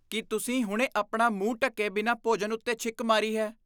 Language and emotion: Punjabi, disgusted